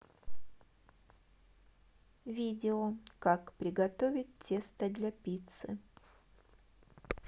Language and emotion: Russian, neutral